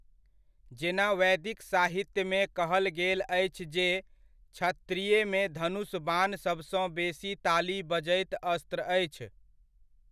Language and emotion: Maithili, neutral